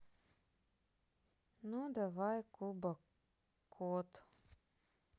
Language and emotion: Russian, sad